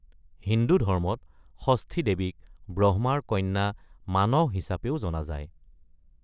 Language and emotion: Assamese, neutral